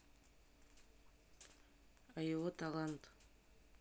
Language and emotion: Russian, neutral